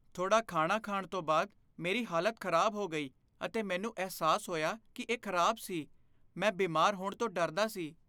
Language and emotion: Punjabi, fearful